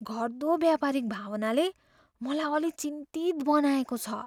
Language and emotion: Nepali, fearful